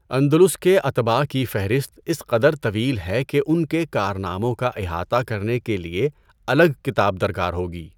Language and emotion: Urdu, neutral